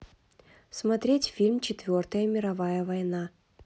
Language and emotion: Russian, neutral